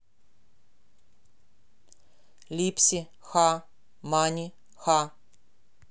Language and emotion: Russian, neutral